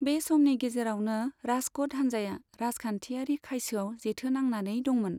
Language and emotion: Bodo, neutral